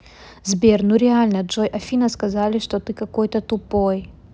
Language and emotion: Russian, angry